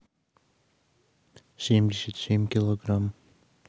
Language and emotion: Russian, neutral